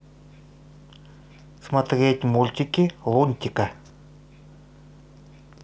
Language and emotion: Russian, neutral